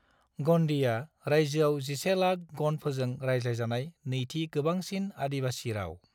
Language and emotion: Bodo, neutral